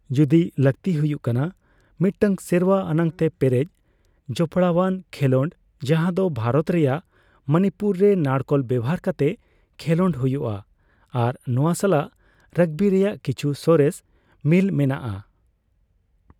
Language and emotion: Santali, neutral